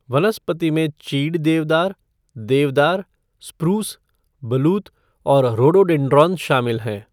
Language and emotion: Hindi, neutral